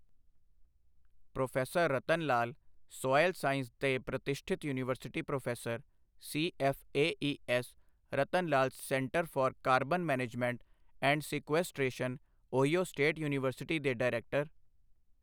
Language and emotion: Punjabi, neutral